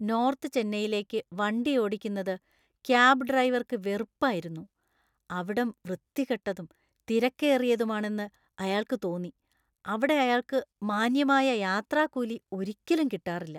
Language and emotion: Malayalam, disgusted